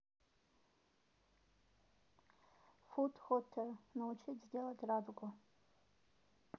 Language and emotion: Russian, neutral